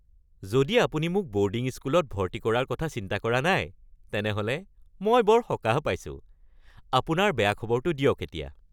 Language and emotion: Assamese, happy